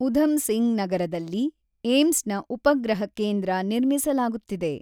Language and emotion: Kannada, neutral